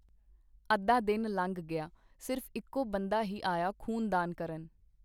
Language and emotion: Punjabi, neutral